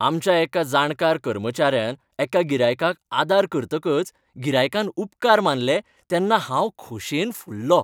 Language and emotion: Goan Konkani, happy